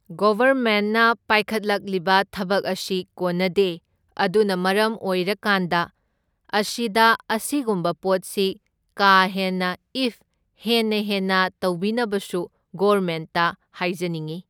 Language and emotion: Manipuri, neutral